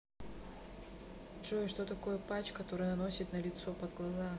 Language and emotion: Russian, neutral